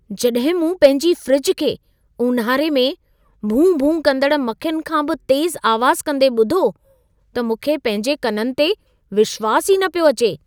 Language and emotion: Sindhi, surprised